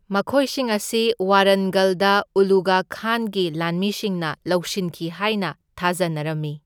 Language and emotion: Manipuri, neutral